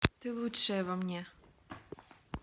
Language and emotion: Russian, positive